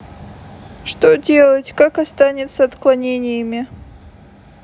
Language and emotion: Russian, sad